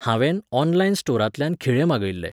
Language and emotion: Goan Konkani, neutral